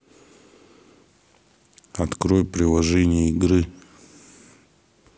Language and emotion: Russian, neutral